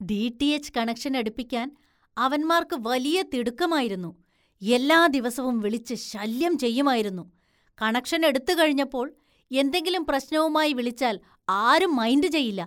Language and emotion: Malayalam, disgusted